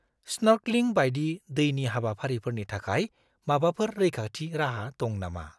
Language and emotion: Bodo, fearful